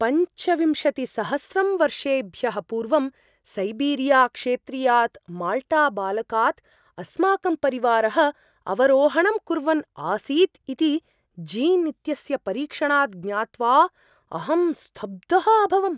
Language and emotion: Sanskrit, surprised